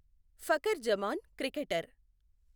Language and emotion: Telugu, neutral